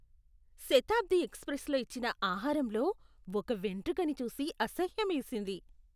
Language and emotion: Telugu, disgusted